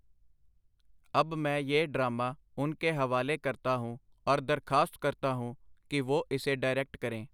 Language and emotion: Punjabi, neutral